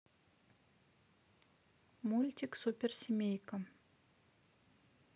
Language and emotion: Russian, neutral